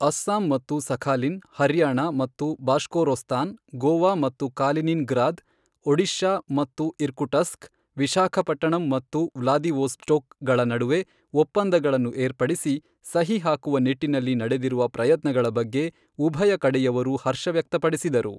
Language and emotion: Kannada, neutral